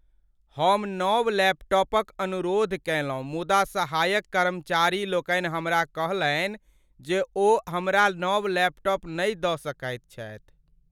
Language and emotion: Maithili, sad